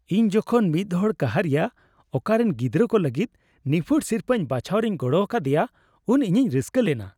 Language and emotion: Santali, happy